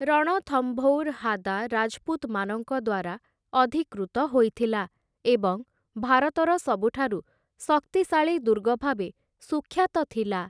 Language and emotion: Odia, neutral